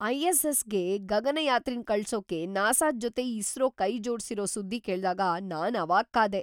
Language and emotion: Kannada, surprised